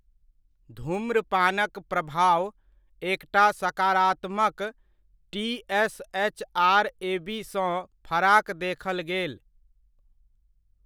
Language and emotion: Maithili, neutral